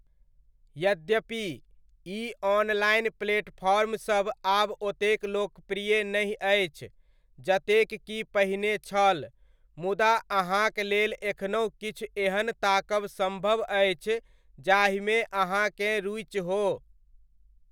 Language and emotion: Maithili, neutral